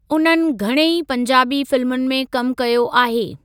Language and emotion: Sindhi, neutral